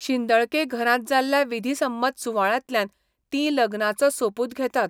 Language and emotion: Goan Konkani, neutral